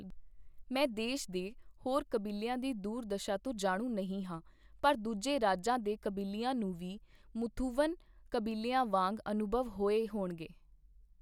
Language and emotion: Punjabi, neutral